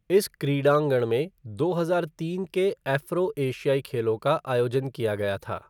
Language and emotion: Hindi, neutral